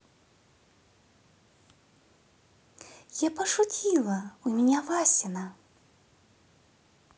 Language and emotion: Russian, positive